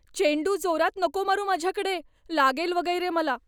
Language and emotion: Marathi, fearful